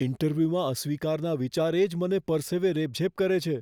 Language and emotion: Gujarati, fearful